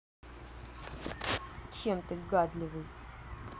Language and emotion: Russian, angry